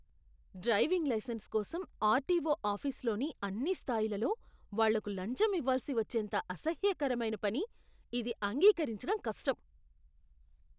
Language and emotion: Telugu, disgusted